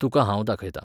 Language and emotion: Goan Konkani, neutral